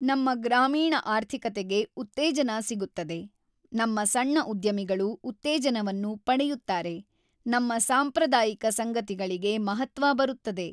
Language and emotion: Kannada, neutral